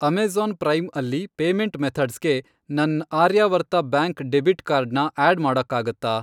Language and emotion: Kannada, neutral